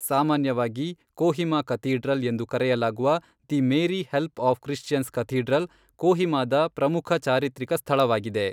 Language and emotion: Kannada, neutral